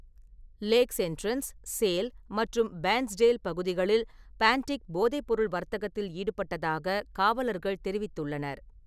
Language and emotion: Tamil, neutral